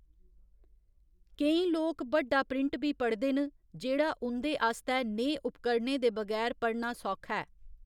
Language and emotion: Dogri, neutral